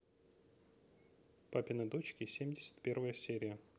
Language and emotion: Russian, neutral